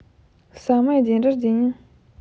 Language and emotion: Russian, neutral